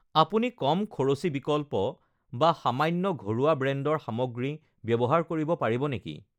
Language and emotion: Assamese, neutral